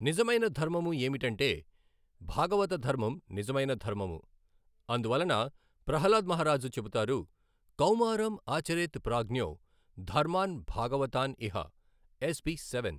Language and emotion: Telugu, neutral